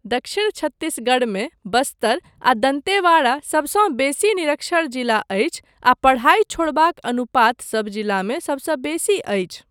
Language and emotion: Maithili, neutral